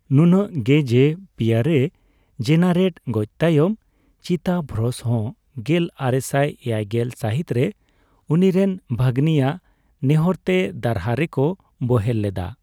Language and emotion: Santali, neutral